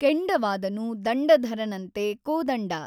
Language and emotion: Kannada, neutral